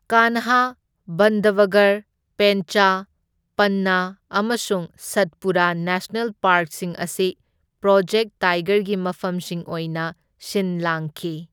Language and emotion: Manipuri, neutral